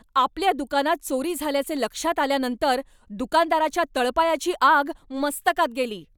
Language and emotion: Marathi, angry